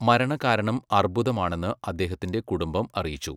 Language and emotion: Malayalam, neutral